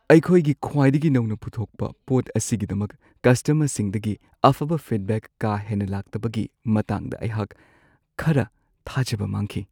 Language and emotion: Manipuri, sad